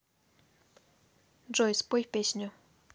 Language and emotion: Russian, neutral